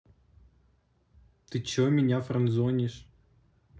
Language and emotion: Russian, neutral